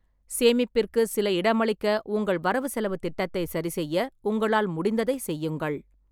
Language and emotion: Tamil, neutral